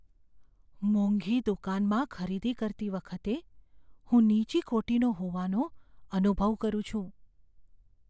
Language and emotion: Gujarati, fearful